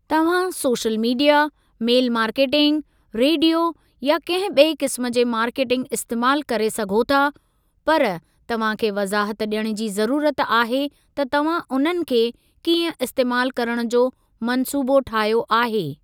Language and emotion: Sindhi, neutral